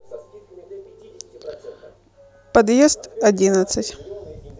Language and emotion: Russian, neutral